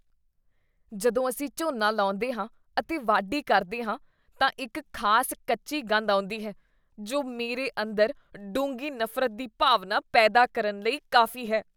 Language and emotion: Punjabi, disgusted